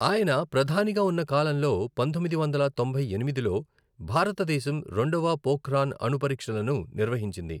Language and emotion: Telugu, neutral